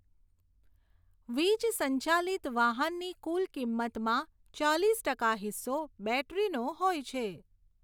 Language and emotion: Gujarati, neutral